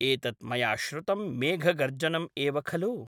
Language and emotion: Sanskrit, neutral